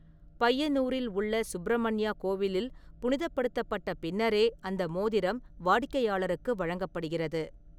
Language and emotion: Tamil, neutral